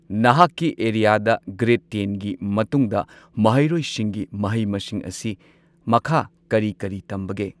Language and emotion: Manipuri, neutral